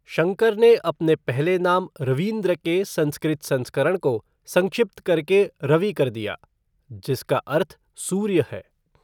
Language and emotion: Hindi, neutral